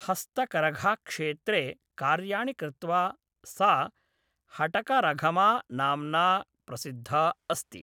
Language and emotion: Sanskrit, neutral